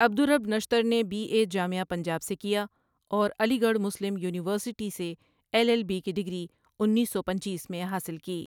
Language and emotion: Urdu, neutral